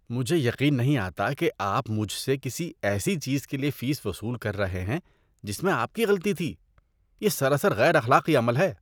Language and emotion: Urdu, disgusted